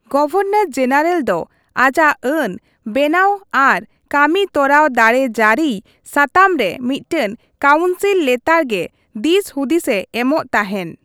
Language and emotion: Santali, neutral